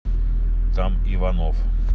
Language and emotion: Russian, neutral